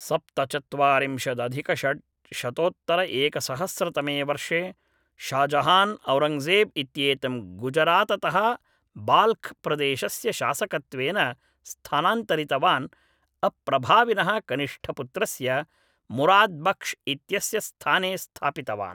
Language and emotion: Sanskrit, neutral